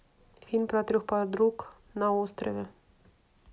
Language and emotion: Russian, neutral